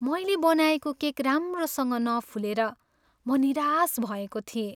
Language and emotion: Nepali, sad